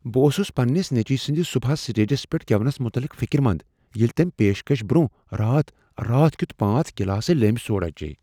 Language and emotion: Kashmiri, fearful